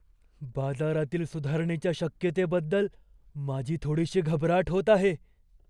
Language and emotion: Marathi, fearful